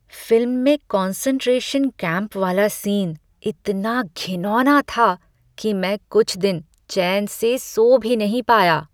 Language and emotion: Hindi, disgusted